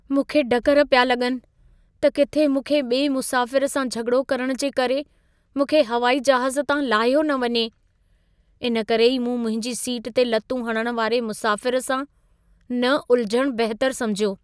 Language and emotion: Sindhi, fearful